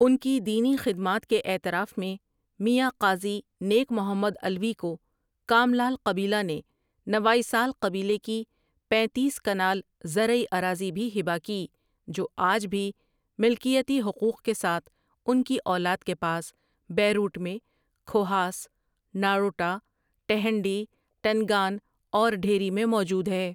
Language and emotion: Urdu, neutral